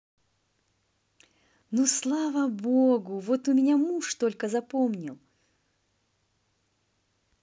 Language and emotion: Russian, positive